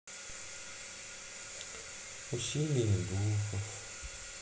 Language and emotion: Russian, sad